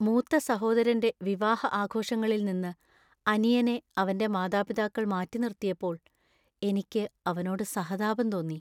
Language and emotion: Malayalam, sad